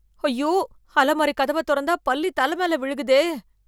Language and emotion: Tamil, fearful